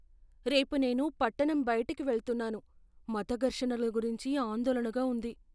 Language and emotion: Telugu, fearful